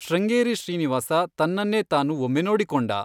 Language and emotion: Kannada, neutral